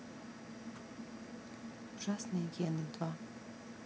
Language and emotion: Russian, neutral